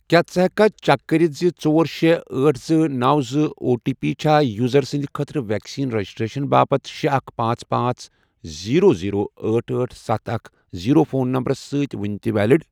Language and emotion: Kashmiri, neutral